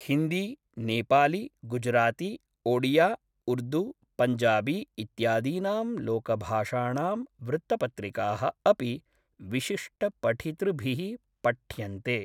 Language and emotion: Sanskrit, neutral